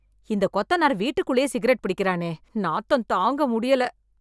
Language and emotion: Tamil, disgusted